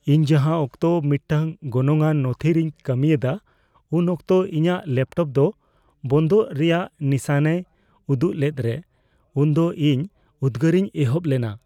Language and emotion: Santali, fearful